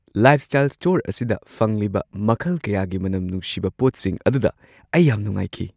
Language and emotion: Manipuri, surprised